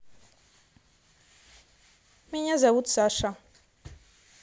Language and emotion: Russian, neutral